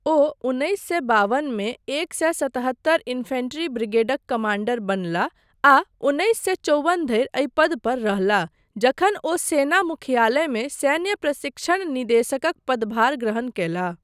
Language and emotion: Maithili, neutral